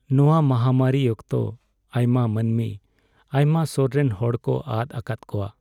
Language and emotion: Santali, sad